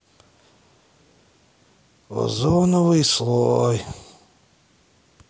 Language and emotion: Russian, sad